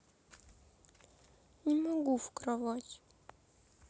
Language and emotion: Russian, sad